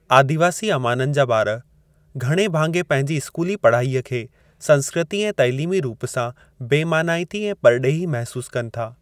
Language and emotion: Sindhi, neutral